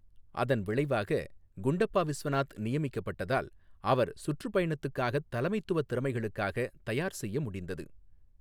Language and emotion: Tamil, neutral